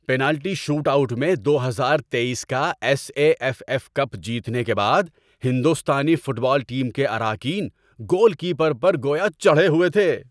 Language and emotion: Urdu, happy